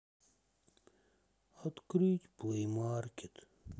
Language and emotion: Russian, sad